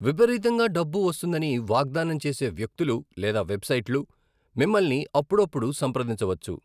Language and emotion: Telugu, neutral